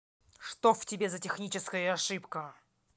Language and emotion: Russian, angry